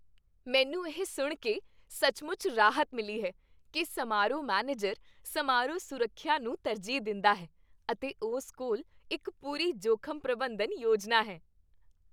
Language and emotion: Punjabi, happy